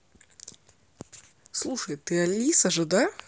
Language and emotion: Russian, neutral